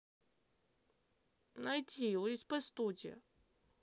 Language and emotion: Russian, neutral